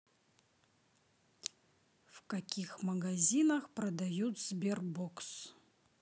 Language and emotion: Russian, neutral